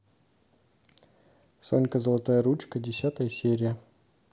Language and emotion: Russian, neutral